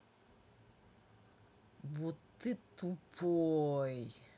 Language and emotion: Russian, angry